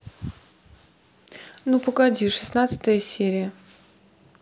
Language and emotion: Russian, neutral